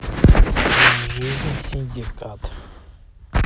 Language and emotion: Russian, neutral